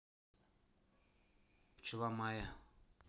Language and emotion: Russian, neutral